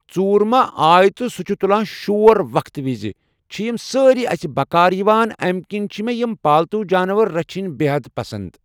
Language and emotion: Kashmiri, neutral